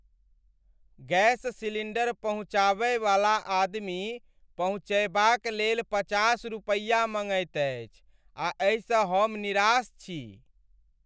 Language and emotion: Maithili, sad